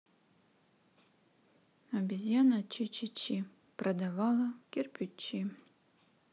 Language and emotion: Russian, sad